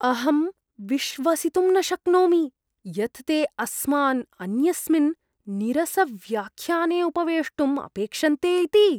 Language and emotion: Sanskrit, disgusted